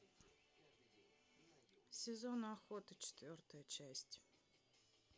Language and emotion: Russian, neutral